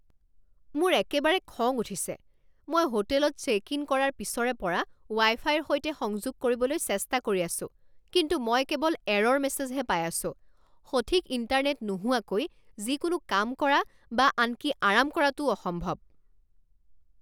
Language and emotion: Assamese, angry